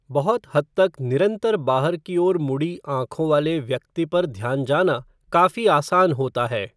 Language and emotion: Hindi, neutral